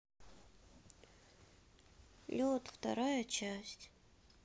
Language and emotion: Russian, sad